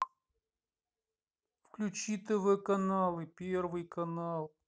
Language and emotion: Russian, angry